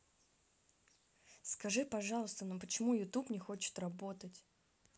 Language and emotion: Russian, angry